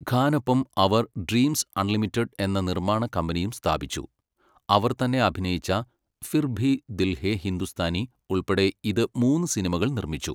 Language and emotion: Malayalam, neutral